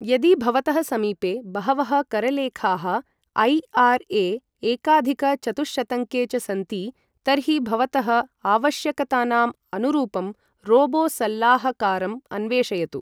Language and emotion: Sanskrit, neutral